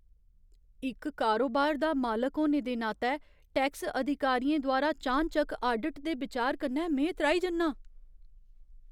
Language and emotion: Dogri, fearful